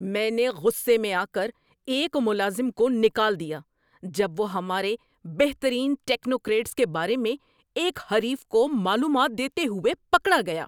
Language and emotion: Urdu, angry